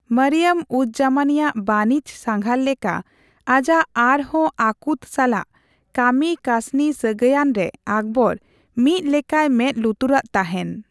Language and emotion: Santali, neutral